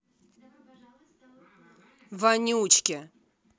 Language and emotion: Russian, angry